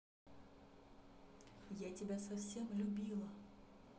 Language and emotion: Russian, neutral